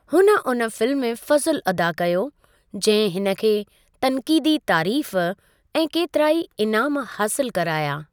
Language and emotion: Sindhi, neutral